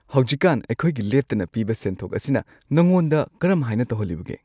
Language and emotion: Manipuri, happy